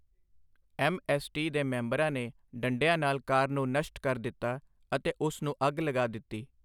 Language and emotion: Punjabi, neutral